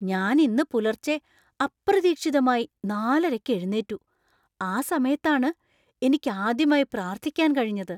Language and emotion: Malayalam, surprised